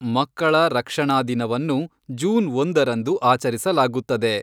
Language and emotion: Kannada, neutral